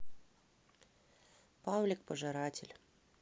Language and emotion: Russian, neutral